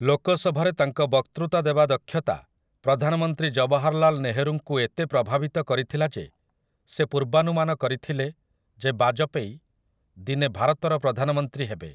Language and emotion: Odia, neutral